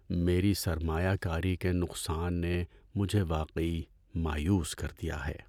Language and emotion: Urdu, sad